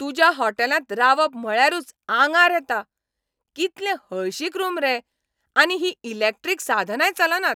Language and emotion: Goan Konkani, angry